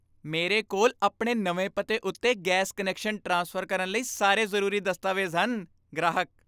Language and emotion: Punjabi, happy